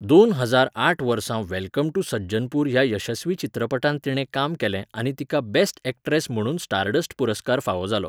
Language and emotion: Goan Konkani, neutral